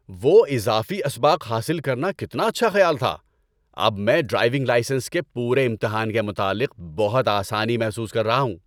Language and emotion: Urdu, happy